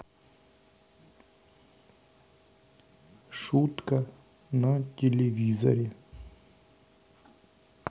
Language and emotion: Russian, neutral